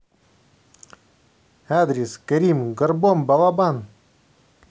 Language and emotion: Russian, positive